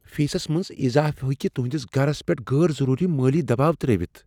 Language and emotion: Kashmiri, fearful